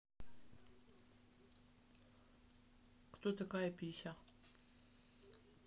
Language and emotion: Russian, neutral